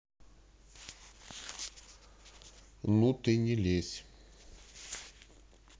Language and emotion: Russian, neutral